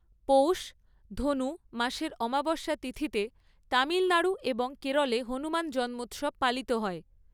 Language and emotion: Bengali, neutral